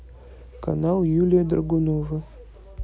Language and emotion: Russian, neutral